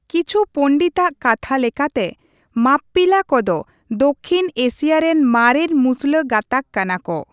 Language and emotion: Santali, neutral